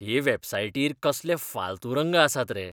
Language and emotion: Goan Konkani, disgusted